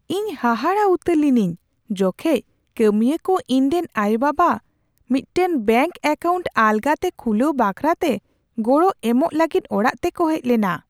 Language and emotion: Santali, surprised